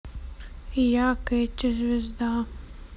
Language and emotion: Russian, sad